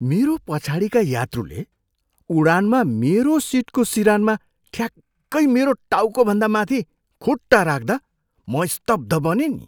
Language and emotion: Nepali, surprised